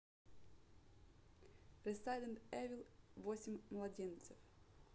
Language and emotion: Russian, neutral